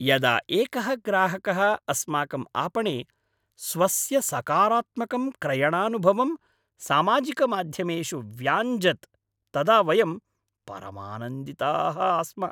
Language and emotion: Sanskrit, happy